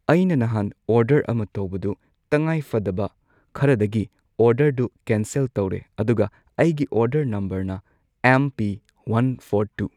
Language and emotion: Manipuri, neutral